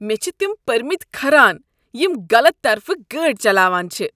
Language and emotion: Kashmiri, disgusted